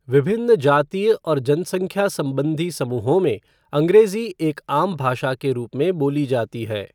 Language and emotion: Hindi, neutral